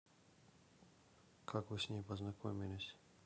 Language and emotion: Russian, neutral